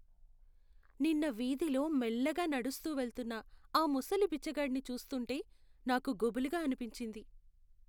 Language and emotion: Telugu, sad